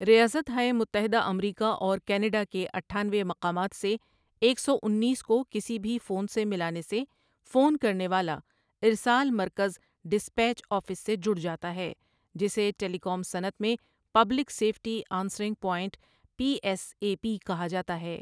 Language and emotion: Urdu, neutral